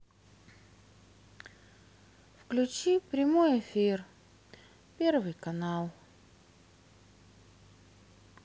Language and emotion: Russian, sad